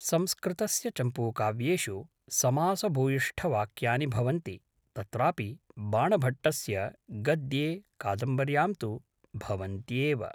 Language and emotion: Sanskrit, neutral